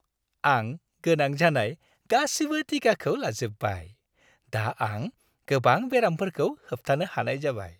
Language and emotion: Bodo, happy